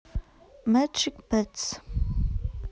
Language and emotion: Russian, neutral